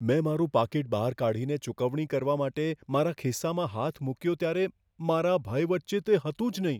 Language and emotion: Gujarati, fearful